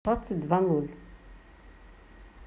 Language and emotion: Russian, neutral